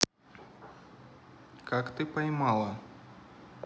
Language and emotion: Russian, neutral